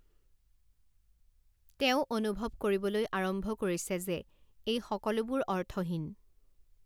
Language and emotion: Assamese, neutral